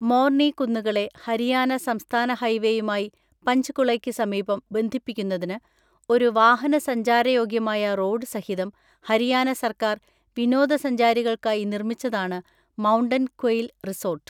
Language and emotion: Malayalam, neutral